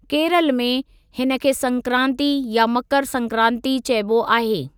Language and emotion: Sindhi, neutral